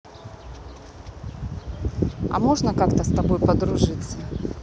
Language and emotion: Russian, neutral